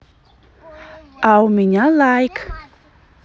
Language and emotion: Russian, positive